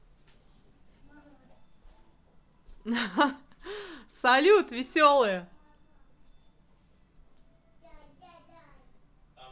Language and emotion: Russian, positive